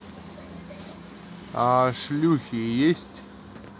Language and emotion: Russian, neutral